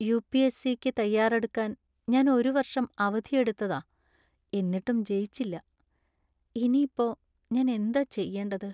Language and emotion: Malayalam, sad